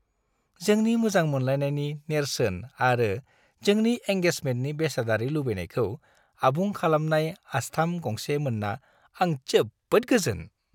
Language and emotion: Bodo, happy